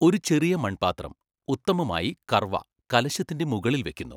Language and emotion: Malayalam, neutral